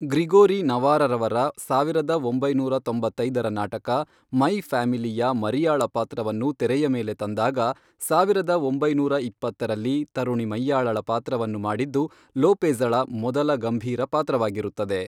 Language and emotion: Kannada, neutral